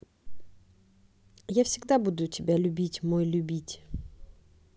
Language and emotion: Russian, neutral